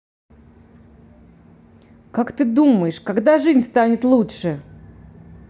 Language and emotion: Russian, angry